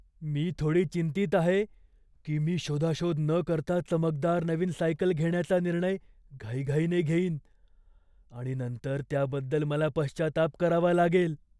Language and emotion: Marathi, fearful